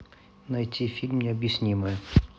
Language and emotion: Russian, neutral